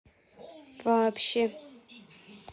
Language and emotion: Russian, neutral